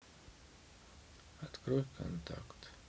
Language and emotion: Russian, sad